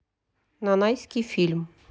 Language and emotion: Russian, neutral